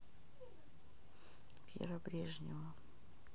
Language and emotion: Russian, sad